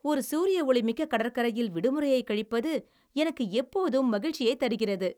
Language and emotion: Tamil, happy